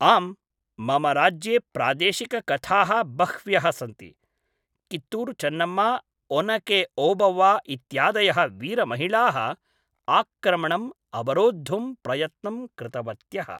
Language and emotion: Sanskrit, neutral